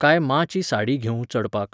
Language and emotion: Goan Konkani, neutral